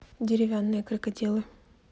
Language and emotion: Russian, neutral